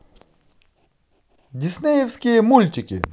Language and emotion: Russian, positive